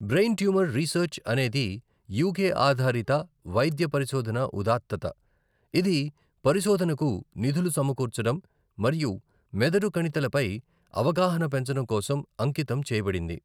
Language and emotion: Telugu, neutral